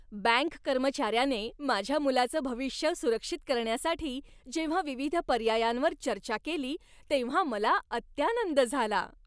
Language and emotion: Marathi, happy